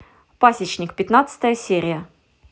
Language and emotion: Russian, neutral